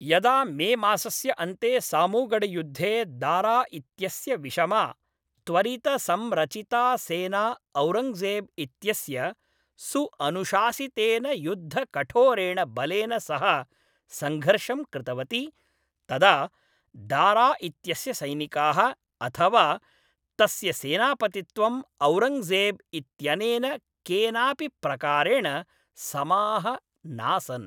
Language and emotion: Sanskrit, neutral